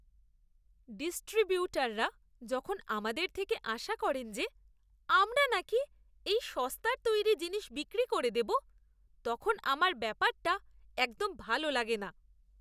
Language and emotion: Bengali, disgusted